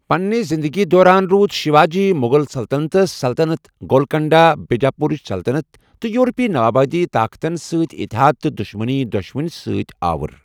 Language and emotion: Kashmiri, neutral